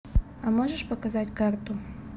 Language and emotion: Russian, neutral